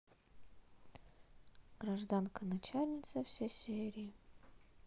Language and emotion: Russian, neutral